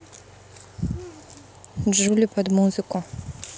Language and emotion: Russian, neutral